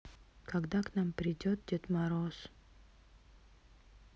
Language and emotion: Russian, sad